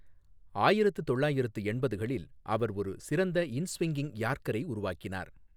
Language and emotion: Tamil, neutral